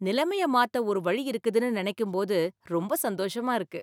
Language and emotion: Tamil, happy